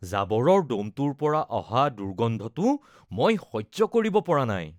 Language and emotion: Assamese, disgusted